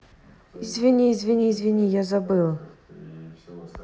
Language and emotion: Russian, neutral